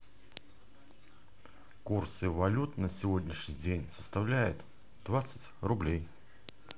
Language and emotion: Russian, neutral